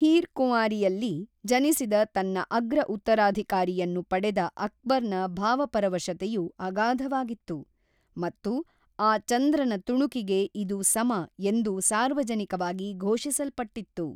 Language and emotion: Kannada, neutral